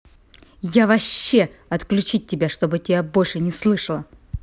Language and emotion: Russian, angry